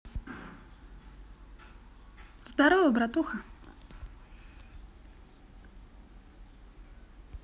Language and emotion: Russian, positive